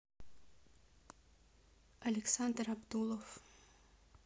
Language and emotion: Russian, neutral